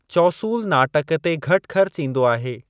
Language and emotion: Sindhi, neutral